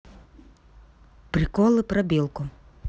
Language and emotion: Russian, neutral